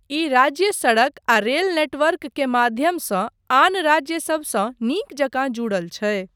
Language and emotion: Maithili, neutral